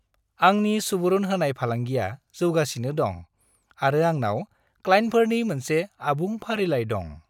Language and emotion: Bodo, happy